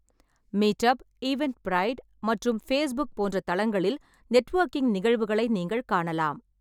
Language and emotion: Tamil, neutral